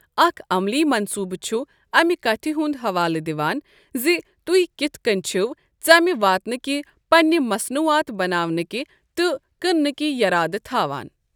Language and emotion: Kashmiri, neutral